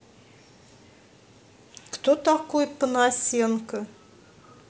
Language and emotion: Russian, neutral